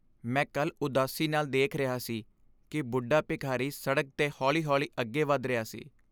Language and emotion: Punjabi, sad